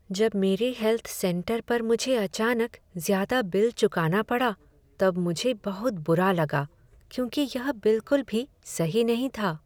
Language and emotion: Hindi, sad